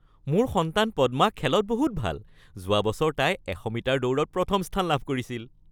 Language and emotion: Assamese, happy